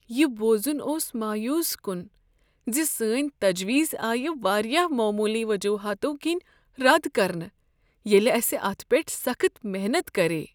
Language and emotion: Kashmiri, sad